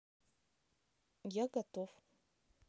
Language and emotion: Russian, neutral